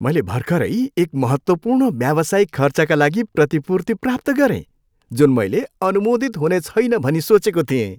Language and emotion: Nepali, happy